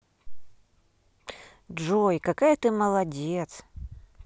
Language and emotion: Russian, positive